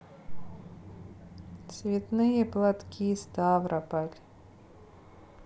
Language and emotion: Russian, sad